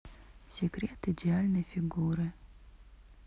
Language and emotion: Russian, neutral